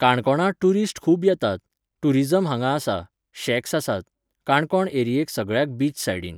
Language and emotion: Goan Konkani, neutral